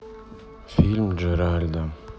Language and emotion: Russian, sad